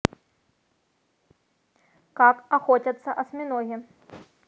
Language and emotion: Russian, neutral